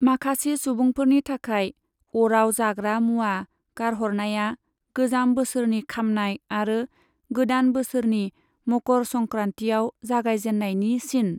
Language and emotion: Bodo, neutral